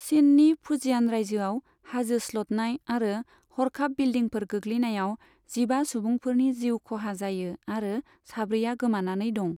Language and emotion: Bodo, neutral